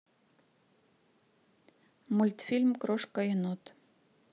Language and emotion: Russian, neutral